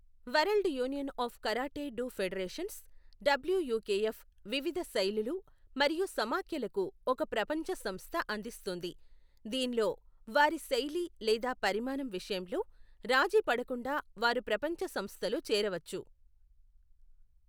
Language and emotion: Telugu, neutral